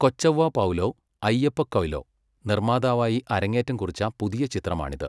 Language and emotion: Malayalam, neutral